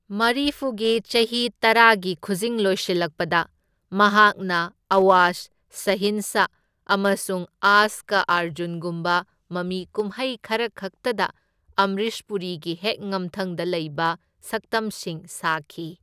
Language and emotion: Manipuri, neutral